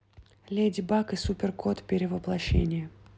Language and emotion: Russian, neutral